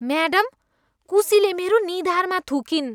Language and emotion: Nepali, disgusted